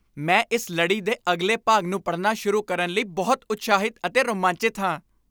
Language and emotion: Punjabi, happy